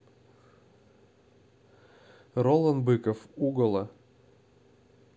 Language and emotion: Russian, neutral